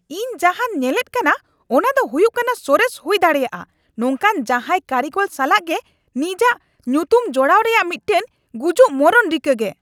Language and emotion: Santali, angry